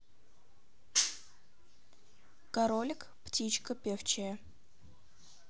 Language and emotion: Russian, neutral